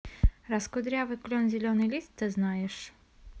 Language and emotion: Russian, neutral